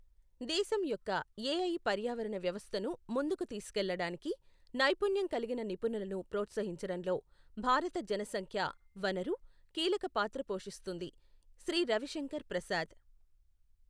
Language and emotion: Telugu, neutral